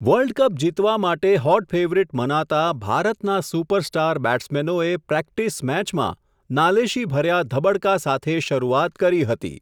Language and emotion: Gujarati, neutral